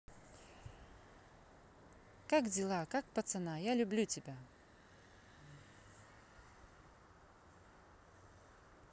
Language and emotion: Russian, positive